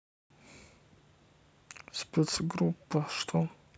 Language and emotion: Russian, neutral